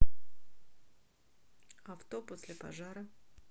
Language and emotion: Russian, neutral